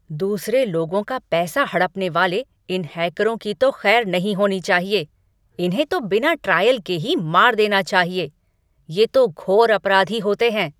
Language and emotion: Hindi, angry